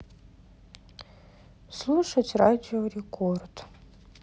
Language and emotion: Russian, sad